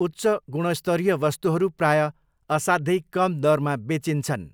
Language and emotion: Nepali, neutral